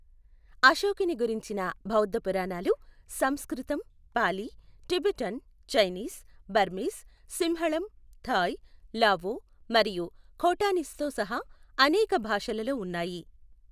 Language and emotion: Telugu, neutral